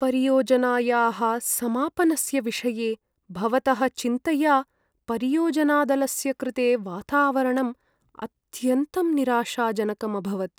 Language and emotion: Sanskrit, sad